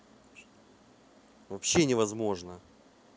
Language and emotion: Russian, angry